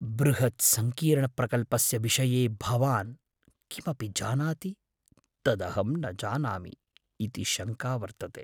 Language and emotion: Sanskrit, fearful